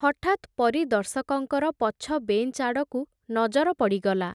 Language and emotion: Odia, neutral